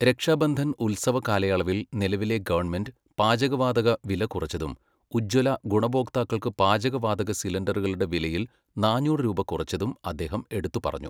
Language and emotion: Malayalam, neutral